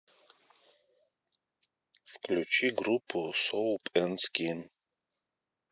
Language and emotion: Russian, neutral